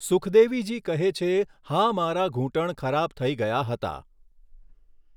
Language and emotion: Gujarati, neutral